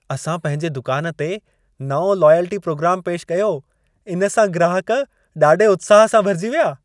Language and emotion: Sindhi, happy